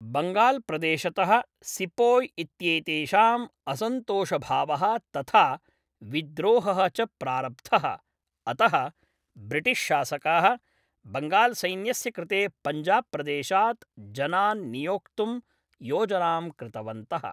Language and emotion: Sanskrit, neutral